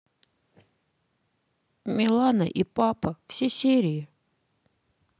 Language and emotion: Russian, sad